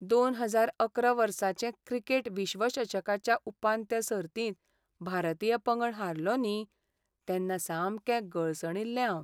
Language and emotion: Goan Konkani, sad